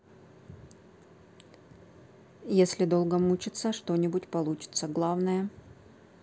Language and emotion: Russian, neutral